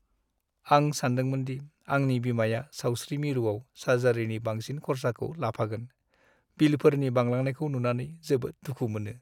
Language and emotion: Bodo, sad